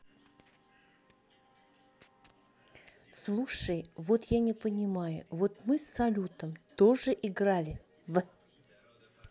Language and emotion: Russian, neutral